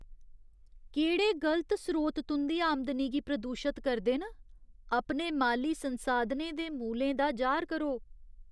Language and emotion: Dogri, disgusted